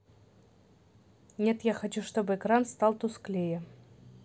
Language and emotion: Russian, neutral